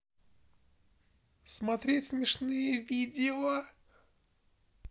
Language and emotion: Russian, neutral